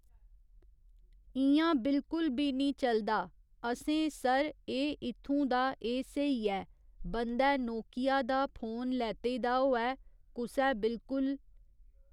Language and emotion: Dogri, neutral